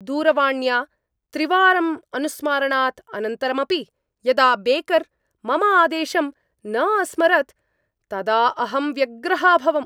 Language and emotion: Sanskrit, angry